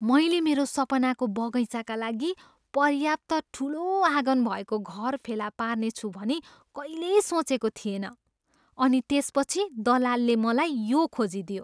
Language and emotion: Nepali, surprised